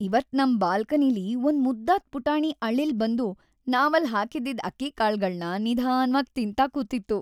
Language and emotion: Kannada, happy